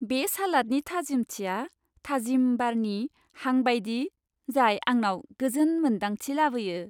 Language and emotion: Bodo, happy